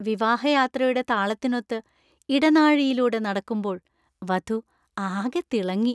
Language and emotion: Malayalam, happy